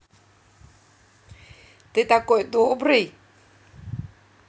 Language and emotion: Russian, positive